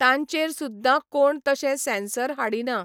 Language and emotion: Goan Konkani, neutral